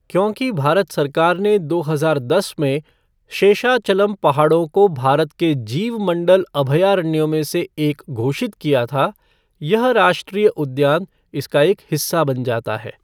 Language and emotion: Hindi, neutral